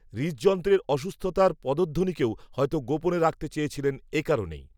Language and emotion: Bengali, neutral